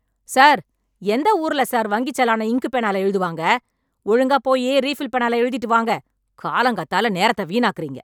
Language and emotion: Tamil, angry